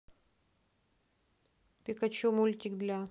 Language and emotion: Russian, neutral